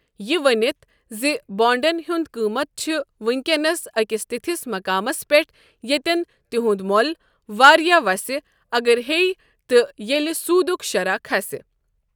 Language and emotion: Kashmiri, neutral